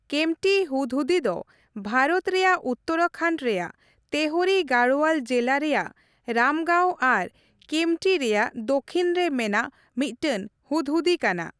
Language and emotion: Santali, neutral